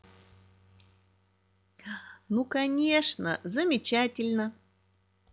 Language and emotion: Russian, positive